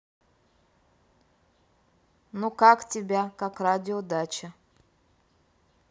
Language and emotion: Russian, neutral